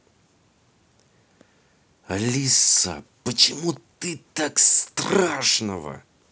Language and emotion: Russian, angry